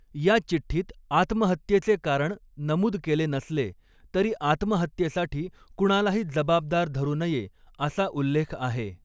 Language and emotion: Marathi, neutral